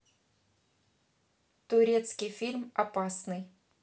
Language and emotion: Russian, neutral